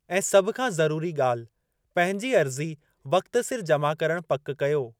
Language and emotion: Sindhi, neutral